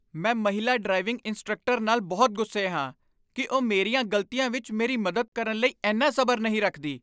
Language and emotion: Punjabi, angry